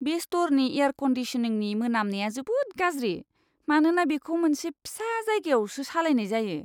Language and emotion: Bodo, disgusted